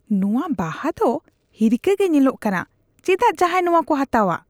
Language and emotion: Santali, disgusted